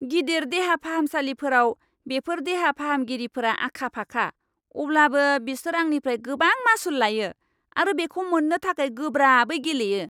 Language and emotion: Bodo, angry